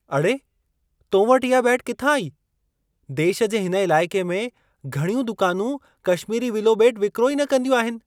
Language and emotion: Sindhi, surprised